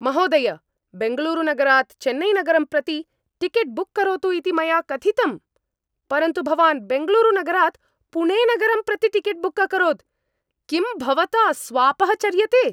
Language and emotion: Sanskrit, angry